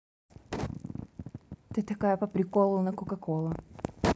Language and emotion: Russian, neutral